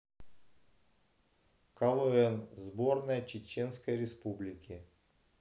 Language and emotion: Russian, neutral